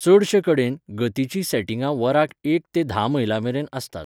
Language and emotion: Goan Konkani, neutral